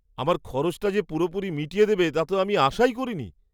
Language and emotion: Bengali, surprised